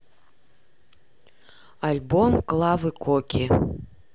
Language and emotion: Russian, neutral